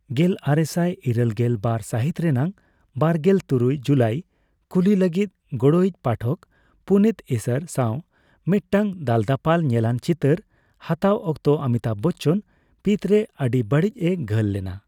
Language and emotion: Santali, neutral